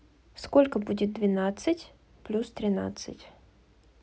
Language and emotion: Russian, neutral